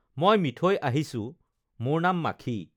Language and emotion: Assamese, neutral